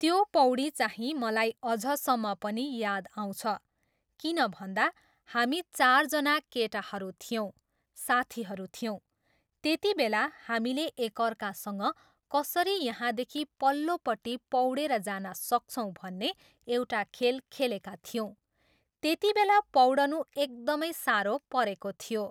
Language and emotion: Nepali, neutral